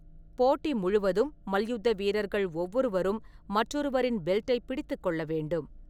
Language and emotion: Tamil, neutral